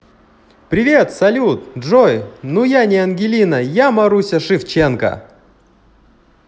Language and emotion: Russian, positive